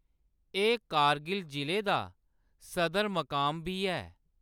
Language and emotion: Dogri, neutral